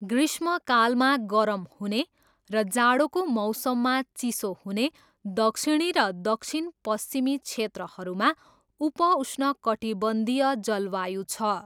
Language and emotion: Nepali, neutral